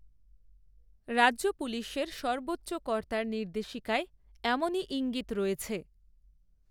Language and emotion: Bengali, neutral